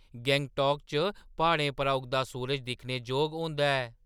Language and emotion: Dogri, surprised